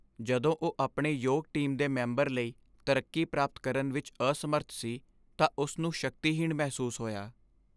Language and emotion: Punjabi, sad